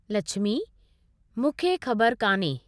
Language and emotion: Sindhi, neutral